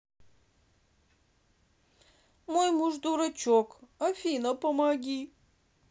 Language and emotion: Russian, sad